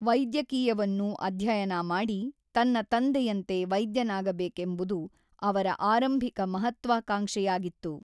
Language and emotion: Kannada, neutral